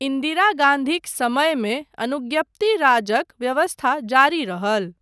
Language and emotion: Maithili, neutral